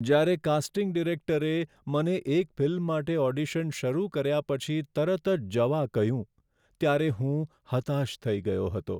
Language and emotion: Gujarati, sad